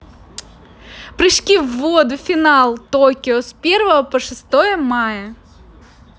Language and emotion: Russian, positive